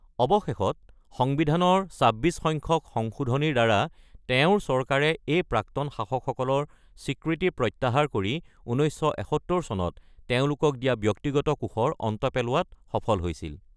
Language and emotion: Assamese, neutral